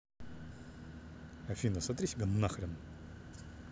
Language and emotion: Russian, angry